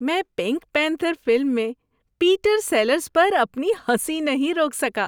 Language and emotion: Urdu, happy